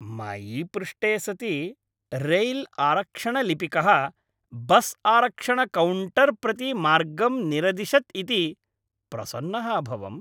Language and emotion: Sanskrit, happy